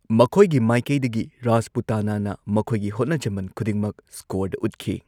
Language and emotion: Manipuri, neutral